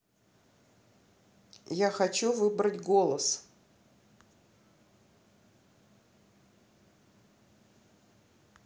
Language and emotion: Russian, neutral